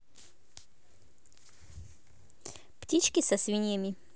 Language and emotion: Russian, positive